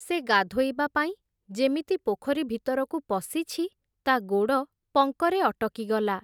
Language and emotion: Odia, neutral